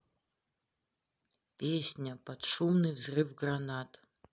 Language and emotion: Russian, neutral